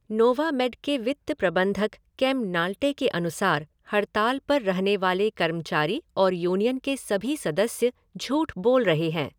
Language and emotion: Hindi, neutral